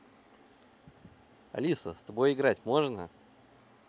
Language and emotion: Russian, positive